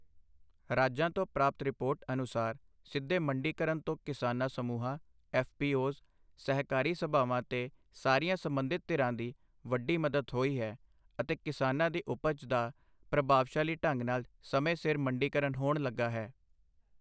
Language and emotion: Punjabi, neutral